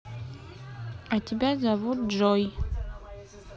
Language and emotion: Russian, neutral